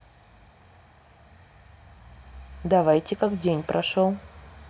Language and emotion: Russian, neutral